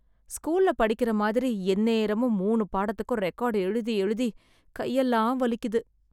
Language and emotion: Tamil, sad